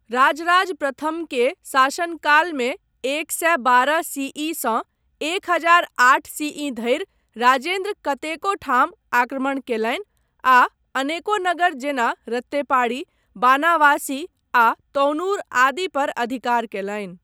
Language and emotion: Maithili, neutral